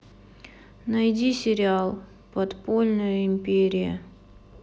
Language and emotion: Russian, sad